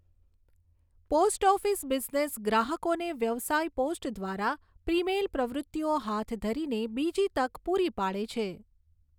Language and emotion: Gujarati, neutral